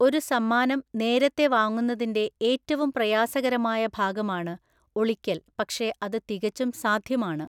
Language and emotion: Malayalam, neutral